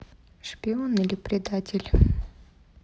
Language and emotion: Russian, neutral